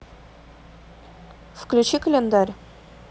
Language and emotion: Russian, neutral